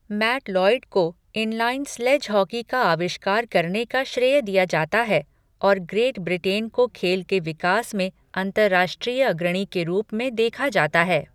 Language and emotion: Hindi, neutral